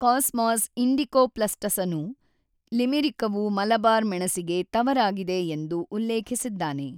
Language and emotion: Kannada, neutral